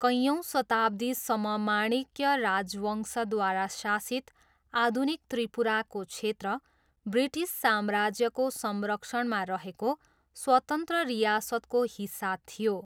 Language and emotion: Nepali, neutral